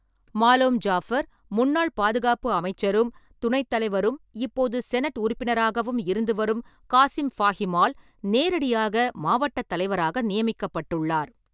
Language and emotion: Tamil, neutral